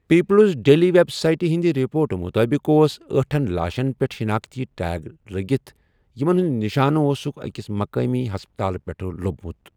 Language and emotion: Kashmiri, neutral